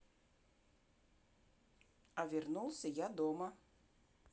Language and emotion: Russian, neutral